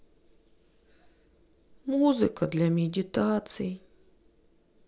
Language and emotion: Russian, sad